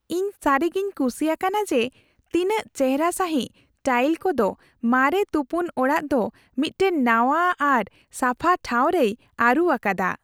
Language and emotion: Santali, happy